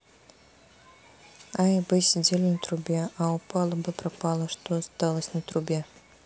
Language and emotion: Russian, neutral